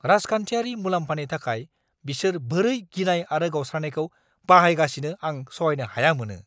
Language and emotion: Bodo, angry